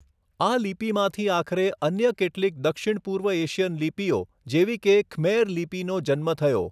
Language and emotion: Gujarati, neutral